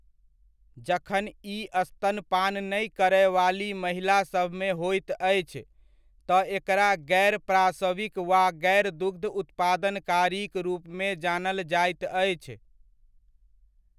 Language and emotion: Maithili, neutral